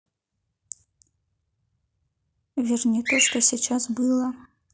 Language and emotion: Russian, neutral